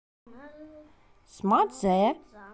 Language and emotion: Russian, neutral